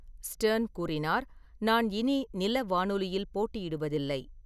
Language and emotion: Tamil, neutral